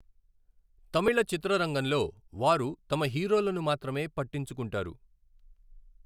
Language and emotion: Telugu, neutral